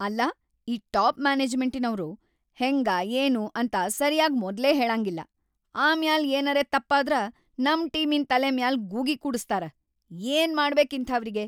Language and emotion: Kannada, angry